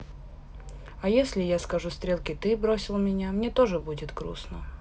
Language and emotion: Russian, sad